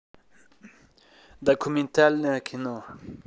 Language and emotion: Russian, neutral